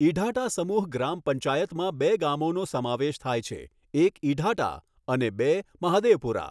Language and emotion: Gujarati, neutral